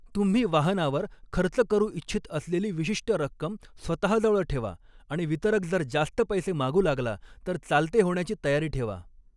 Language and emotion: Marathi, neutral